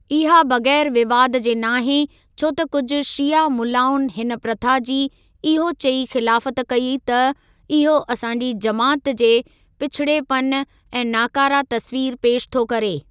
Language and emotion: Sindhi, neutral